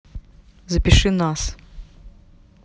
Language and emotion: Russian, neutral